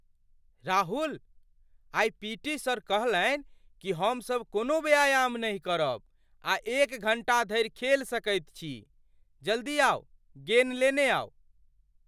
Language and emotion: Maithili, surprised